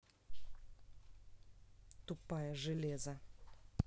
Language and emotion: Russian, angry